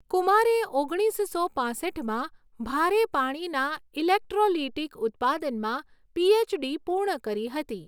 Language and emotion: Gujarati, neutral